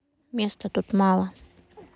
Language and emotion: Russian, sad